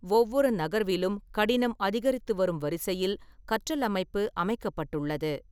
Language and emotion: Tamil, neutral